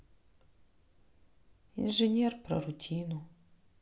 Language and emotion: Russian, sad